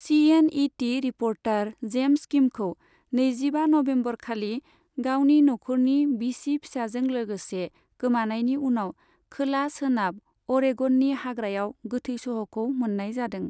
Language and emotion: Bodo, neutral